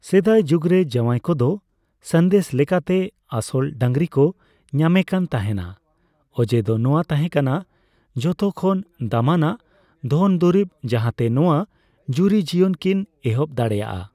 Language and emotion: Santali, neutral